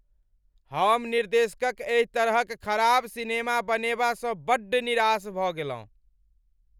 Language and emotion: Maithili, angry